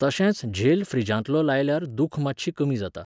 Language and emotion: Goan Konkani, neutral